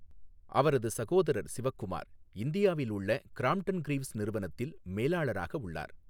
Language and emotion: Tamil, neutral